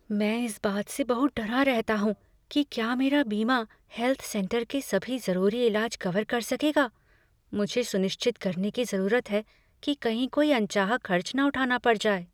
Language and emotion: Hindi, fearful